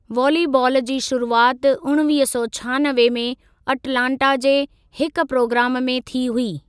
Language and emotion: Sindhi, neutral